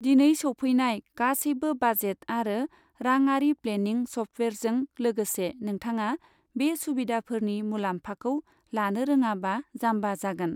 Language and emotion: Bodo, neutral